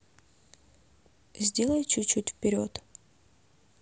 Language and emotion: Russian, neutral